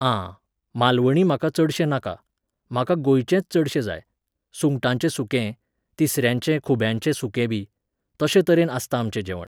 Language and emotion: Goan Konkani, neutral